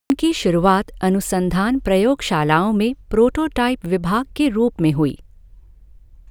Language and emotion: Hindi, neutral